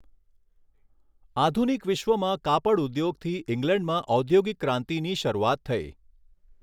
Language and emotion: Gujarati, neutral